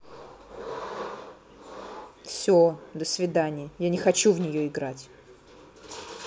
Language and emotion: Russian, angry